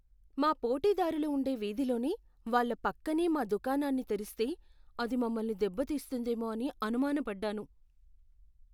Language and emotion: Telugu, fearful